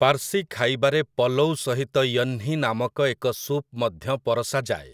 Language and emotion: Odia, neutral